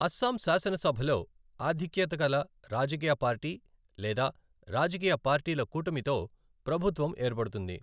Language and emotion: Telugu, neutral